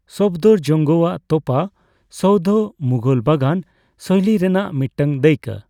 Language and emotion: Santali, neutral